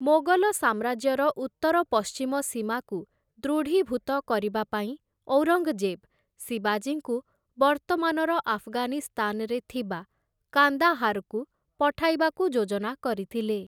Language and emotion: Odia, neutral